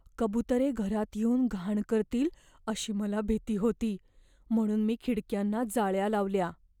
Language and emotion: Marathi, fearful